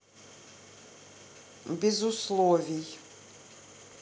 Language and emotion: Russian, neutral